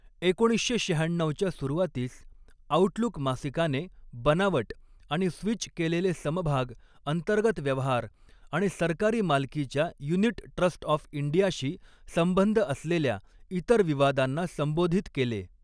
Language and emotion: Marathi, neutral